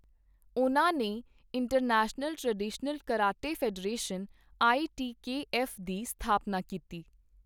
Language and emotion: Punjabi, neutral